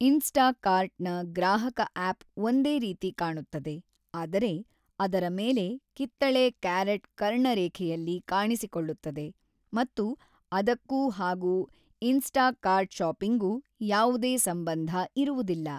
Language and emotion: Kannada, neutral